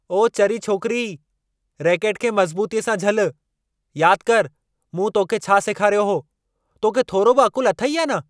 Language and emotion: Sindhi, angry